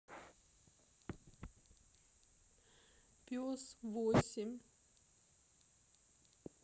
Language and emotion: Russian, sad